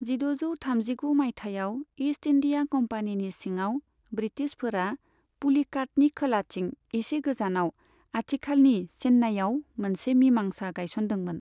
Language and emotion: Bodo, neutral